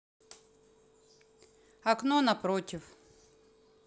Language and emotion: Russian, neutral